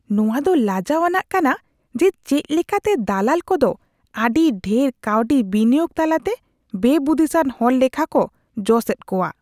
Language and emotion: Santali, disgusted